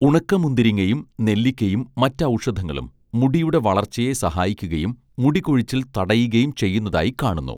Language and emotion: Malayalam, neutral